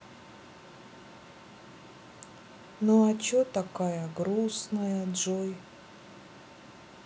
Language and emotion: Russian, sad